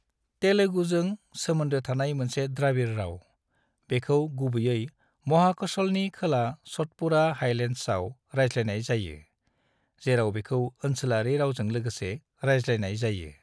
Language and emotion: Bodo, neutral